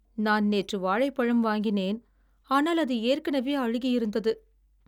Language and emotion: Tamil, sad